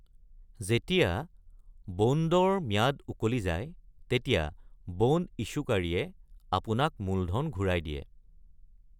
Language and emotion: Assamese, neutral